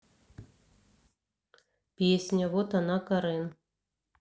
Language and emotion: Russian, neutral